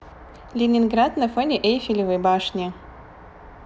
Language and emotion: Russian, positive